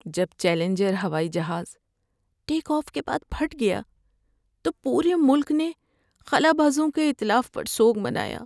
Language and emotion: Urdu, sad